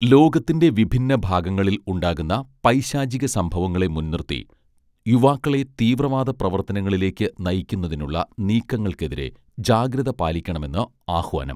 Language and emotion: Malayalam, neutral